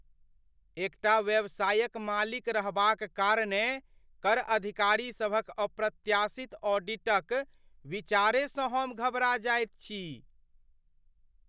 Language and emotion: Maithili, fearful